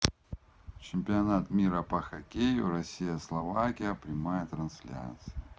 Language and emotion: Russian, neutral